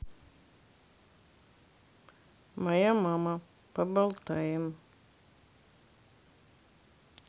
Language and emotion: Russian, neutral